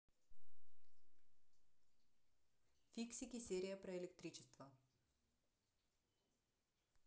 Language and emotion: Russian, neutral